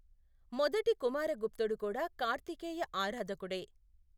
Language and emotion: Telugu, neutral